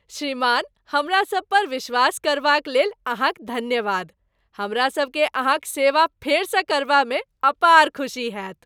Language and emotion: Maithili, happy